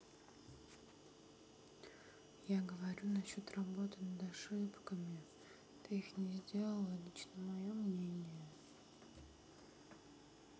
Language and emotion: Russian, sad